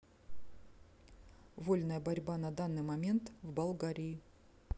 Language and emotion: Russian, neutral